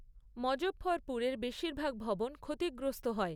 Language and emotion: Bengali, neutral